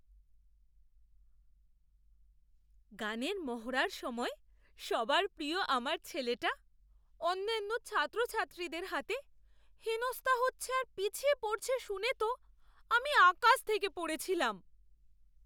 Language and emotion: Bengali, surprised